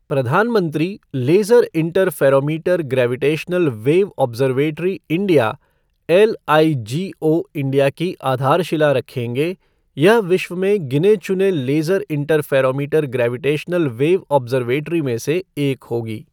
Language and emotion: Hindi, neutral